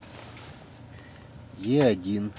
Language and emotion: Russian, neutral